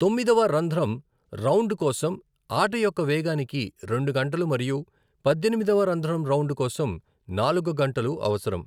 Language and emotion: Telugu, neutral